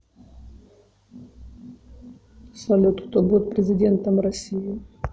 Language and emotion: Russian, neutral